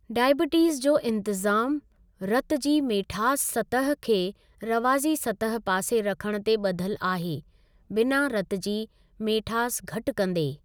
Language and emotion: Sindhi, neutral